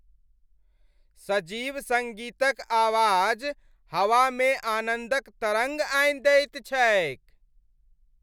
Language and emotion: Maithili, happy